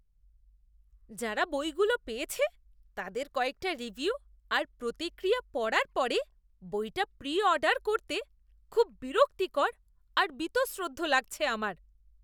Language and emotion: Bengali, disgusted